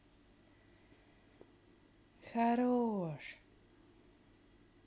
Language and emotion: Russian, positive